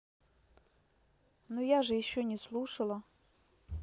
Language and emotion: Russian, neutral